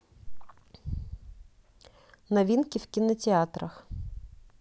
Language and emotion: Russian, neutral